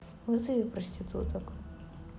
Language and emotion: Russian, neutral